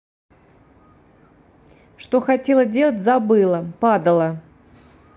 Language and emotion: Russian, neutral